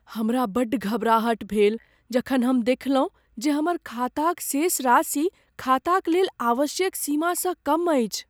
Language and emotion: Maithili, fearful